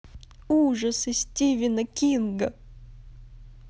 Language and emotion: Russian, positive